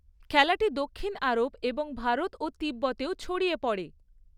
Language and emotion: Bengali, neutral